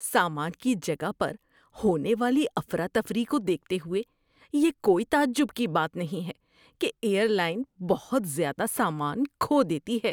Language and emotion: Urdu, disgusted